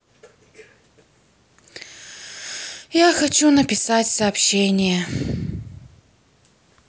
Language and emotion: Russian, sad